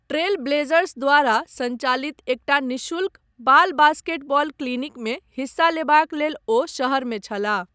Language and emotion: Maithili, neutral